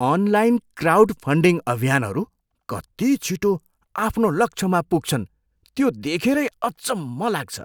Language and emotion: Nepali, surprised